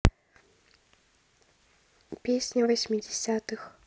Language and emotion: Russian, neutral